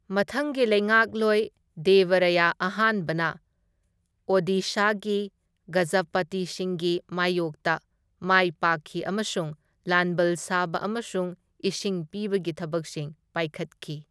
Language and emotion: Manipuri, neutral